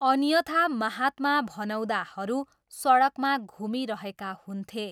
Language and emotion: Nepali, neutral